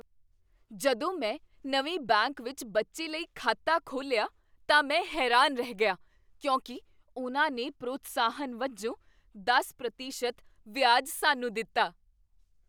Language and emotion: Punjabi, surprised